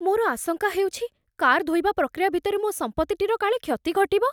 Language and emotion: Odia, fearful